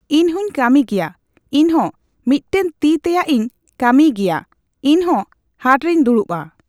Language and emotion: Santali, neutral